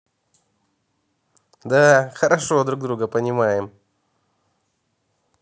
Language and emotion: Russian, positive